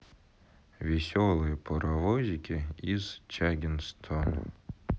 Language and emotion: Russian, sad